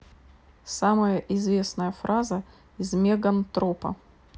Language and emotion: Russian, neutral